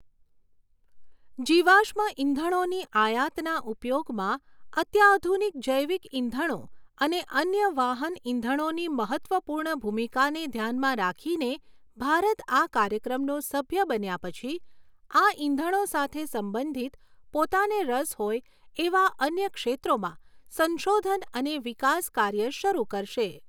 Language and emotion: Gujarati, neutral